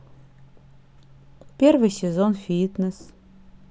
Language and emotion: Russian, neutral